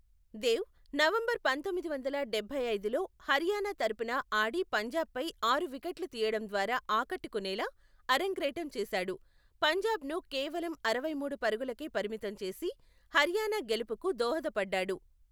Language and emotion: Telugu, neutral